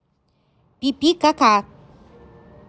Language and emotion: Russian, neutral